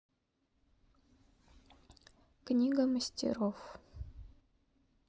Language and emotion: Russian, neutral